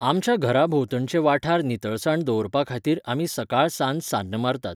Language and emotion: Goan Konkani, neutral